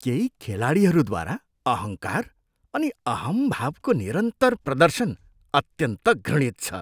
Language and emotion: Nepali, disgusted